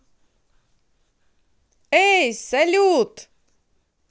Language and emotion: Russian, positive